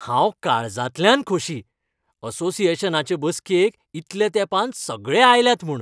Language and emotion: Goan Konkani, happy